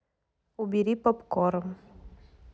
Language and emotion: Russian, neutral